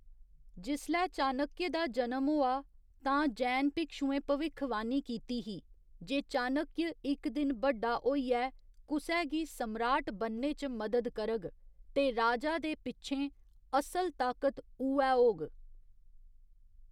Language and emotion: Dogri, neutral